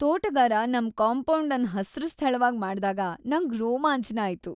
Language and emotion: Kannada, happy